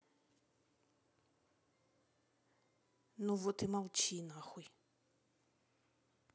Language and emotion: Russian, angry